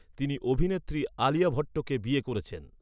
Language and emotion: Bengali, neutral